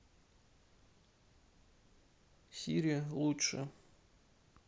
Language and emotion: Russian, neutral